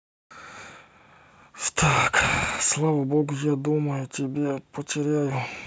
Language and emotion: Russian, sad